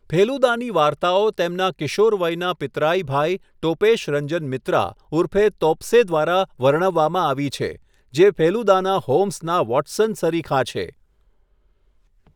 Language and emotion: Gujarati, neutral